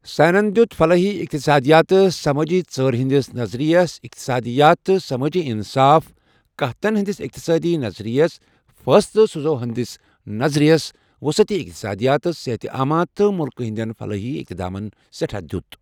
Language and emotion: Kashmiri, neutral